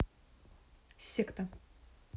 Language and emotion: Russian, neutral